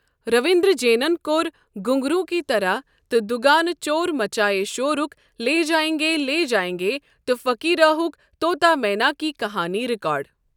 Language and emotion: Kashmiri, neutral